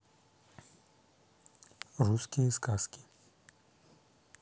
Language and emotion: Russian, neutral